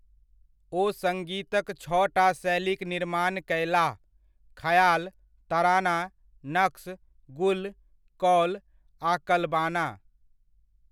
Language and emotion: Maithili, neutral